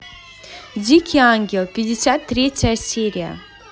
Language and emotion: Russian, positive